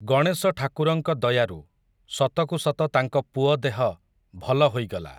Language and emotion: Odia, neutral